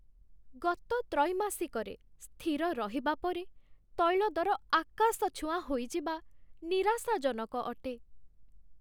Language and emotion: Odia, sad